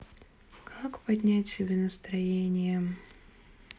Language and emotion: Russian, sad